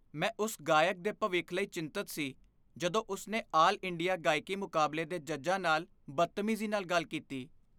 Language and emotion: Punjabi, fearful